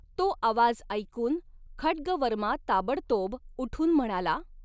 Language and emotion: Marathi, neutral